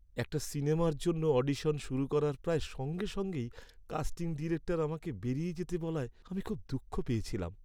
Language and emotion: Bengali, sad